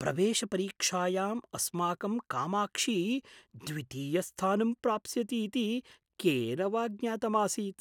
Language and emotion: Sanskrit, surprised